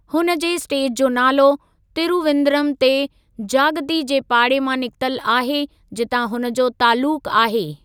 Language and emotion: Sindhi, neutral